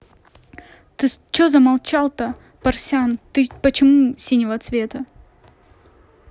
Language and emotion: Russian, angry